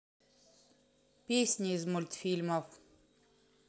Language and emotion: Russian, neutral